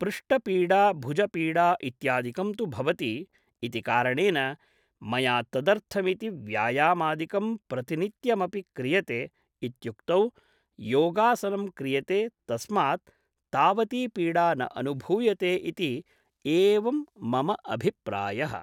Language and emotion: Sanskrit, neutral